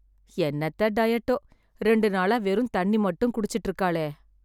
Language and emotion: Tamil, sad